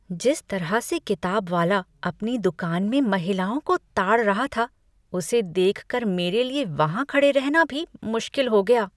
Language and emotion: Hindi, disgusted